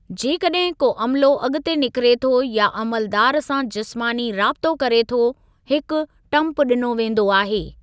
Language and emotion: Sindhi, neutral